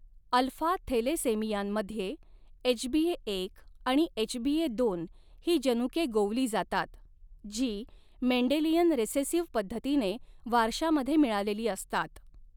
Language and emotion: Marathi, neutral